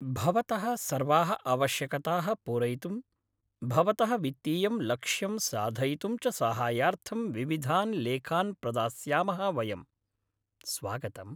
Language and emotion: Sanskrit, happy